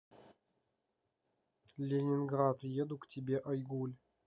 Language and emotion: Russian, neutral